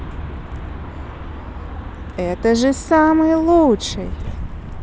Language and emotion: Russian, positive